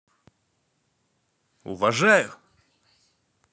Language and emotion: Russian, positive